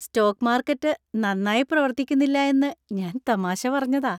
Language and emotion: Malayalam, happy